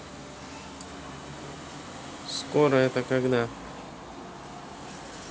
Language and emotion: Russian, neutral